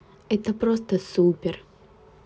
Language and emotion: Russian, positive